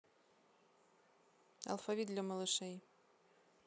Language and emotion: Russian, neutral